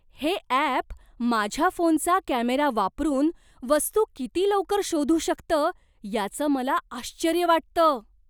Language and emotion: Marathi, surprised